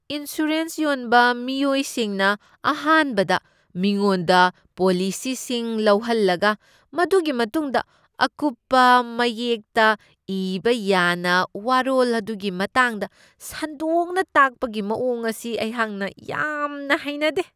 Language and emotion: Manipuri, disgusted